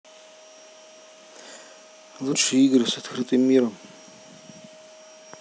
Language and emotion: Russian, neutral